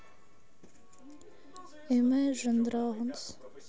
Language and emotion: Russian, sad